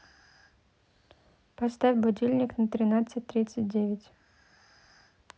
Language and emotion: Russian, neutral